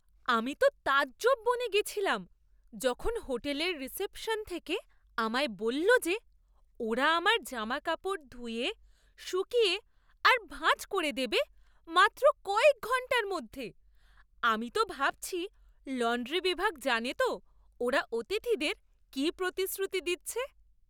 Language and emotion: Bengali, surprised